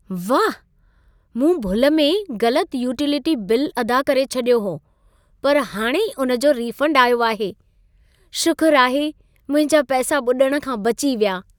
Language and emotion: Sindhi, happy